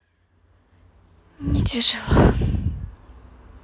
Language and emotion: Russian, sad